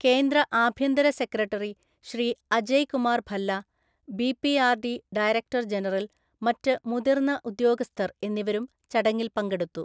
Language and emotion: Malayalam, neutral